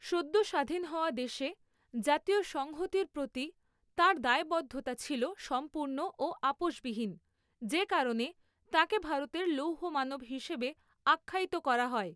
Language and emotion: Bengali, neutral